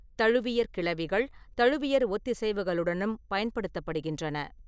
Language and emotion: Tamil, neutral